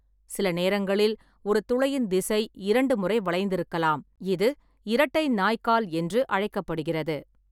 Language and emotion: Tamil, neutral